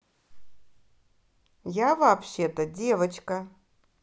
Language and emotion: Russian, angry